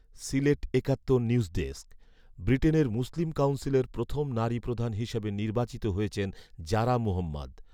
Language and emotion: Bengali, neutral